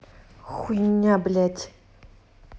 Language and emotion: Russian, angry